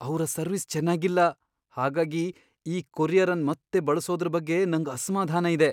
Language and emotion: Kannada, fearful